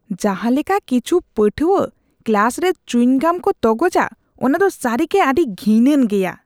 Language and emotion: Santali, disgusted